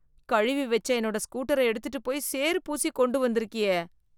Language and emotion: Tamil, disgusted